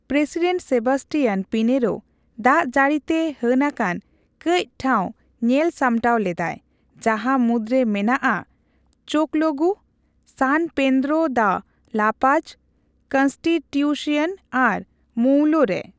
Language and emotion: Santali, neutral